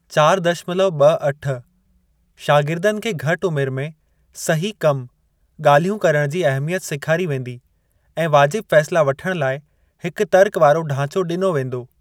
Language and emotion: Sindhi, neutral